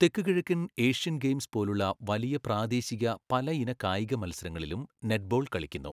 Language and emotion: Malayalam, neutral